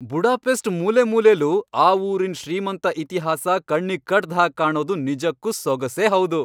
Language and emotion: Kannada, happy